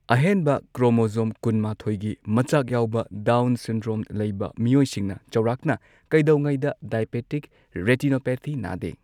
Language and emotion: Manipuri, neutral